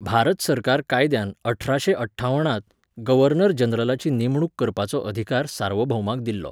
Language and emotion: Goan Konkani, neutral